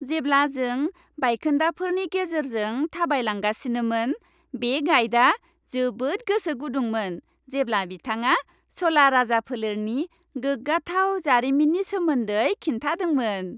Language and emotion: Bodo, happy